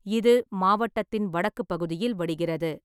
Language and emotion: Tamil, neutral